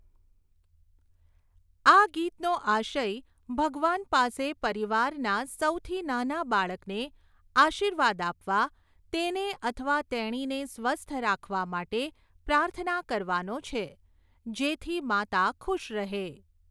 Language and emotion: Gujarati, neutral